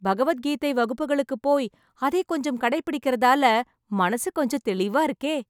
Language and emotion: Tamil, happy